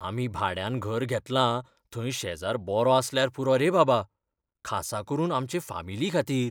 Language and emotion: Goan Konkani, fearful